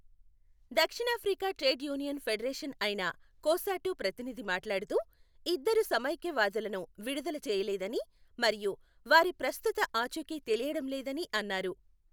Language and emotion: Telugu, neutral